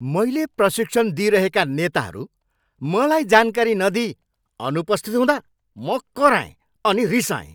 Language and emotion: Nepali, angry